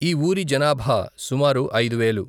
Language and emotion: Telugu, neutral